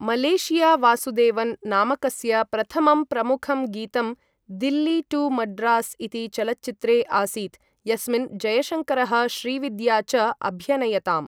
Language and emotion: Sanskrit, neutral